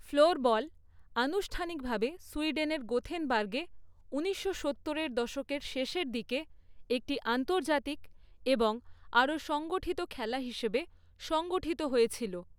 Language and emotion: Bengali, neutral